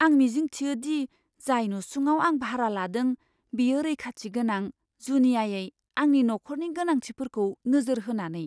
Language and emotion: Bodo, fearful